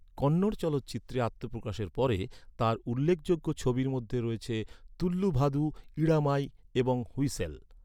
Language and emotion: Bengali, neutral